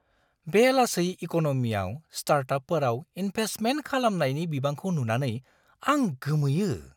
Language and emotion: Bodo, surprised